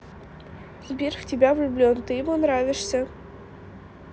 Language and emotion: Russian, neutral